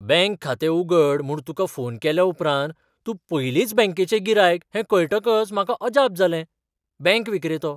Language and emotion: Goan Konkani, surprised